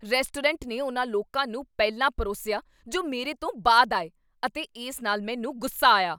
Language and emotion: Punjabi, angry